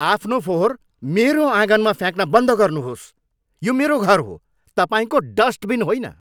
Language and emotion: Nepali, angry